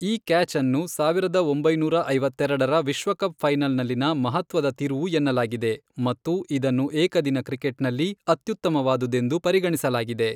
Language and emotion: Kannada, neutral